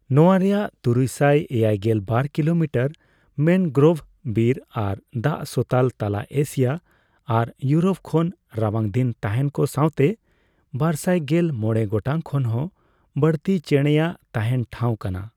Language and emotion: Santali, neutral